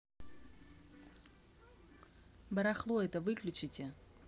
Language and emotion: Russian, angry